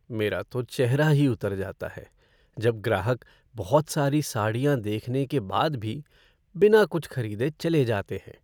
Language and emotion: Hindi, sad